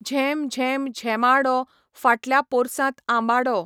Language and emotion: Goan Konkani, neutral